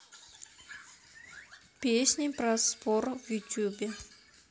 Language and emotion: Russian, neutral